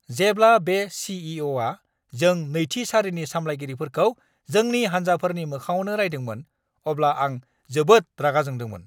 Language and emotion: Bodo, angry